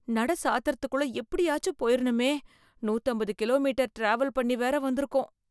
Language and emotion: Tamil, fearful